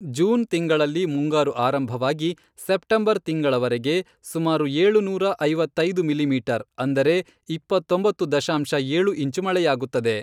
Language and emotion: Kannada, neutral